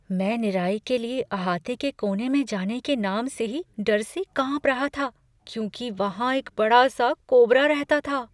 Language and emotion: Hindi, fearful